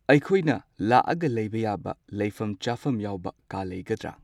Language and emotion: Manipuri, neutral